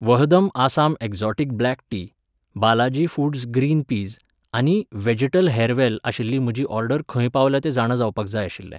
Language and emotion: Goan Konkani, neutral